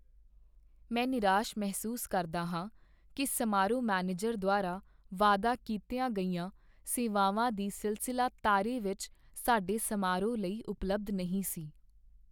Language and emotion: Punjabi, sad